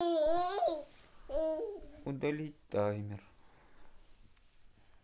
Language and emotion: Russian, sad